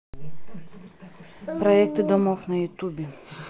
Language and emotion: Russian, neutral